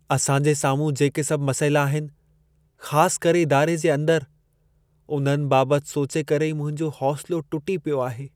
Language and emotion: Sindhi, sad